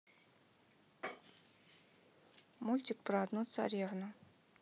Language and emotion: Russian, neutral